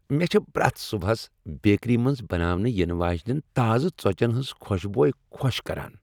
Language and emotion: Kashmiri, happy